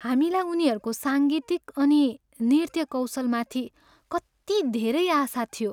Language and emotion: Nepali, sad